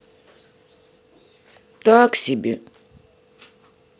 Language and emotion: Russian, sad